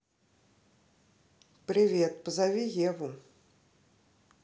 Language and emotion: Russian, neutral